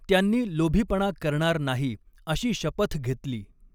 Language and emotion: Marathi, neutral